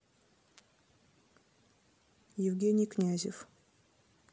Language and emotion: Russian, neutral